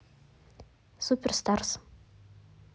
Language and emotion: Russian, neutral